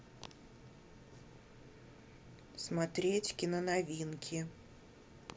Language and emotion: Russian, neutral